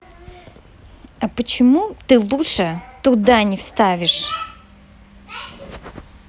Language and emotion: Russian, angry